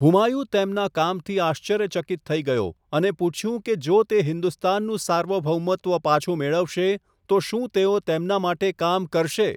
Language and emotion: Gujarati, neutral